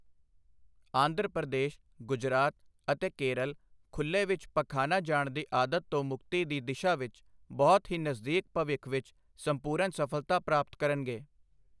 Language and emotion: Punjabi, neutral